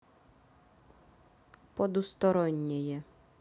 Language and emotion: Russian, neutral